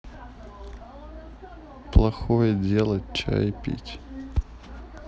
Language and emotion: Russian, sad